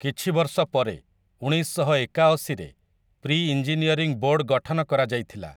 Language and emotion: Odia, neutral